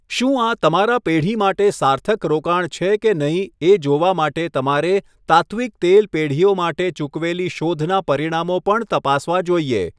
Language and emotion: Gujarati, neutral